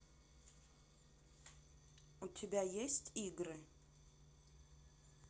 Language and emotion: Russian, neutral